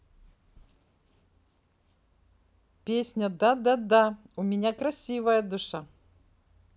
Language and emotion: Russian, positive